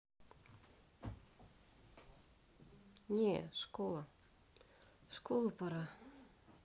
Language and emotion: Russian, sad